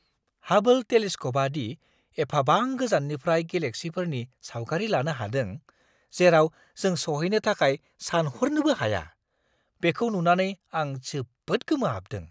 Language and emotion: Bodo, surprised